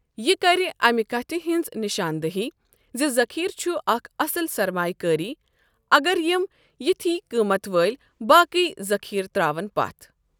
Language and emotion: Kashmiri, neutral